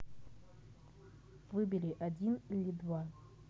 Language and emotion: Russian, neutral